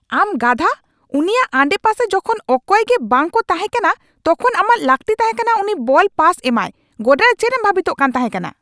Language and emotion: Santali, angry